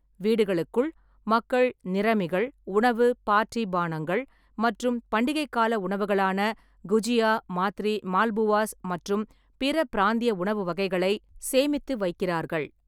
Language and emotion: Tamil, neutral